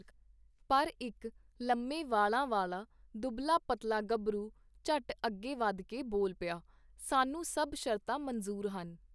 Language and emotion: Punjabi, neutral